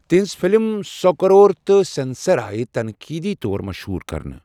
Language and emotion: Kashmiri, neutral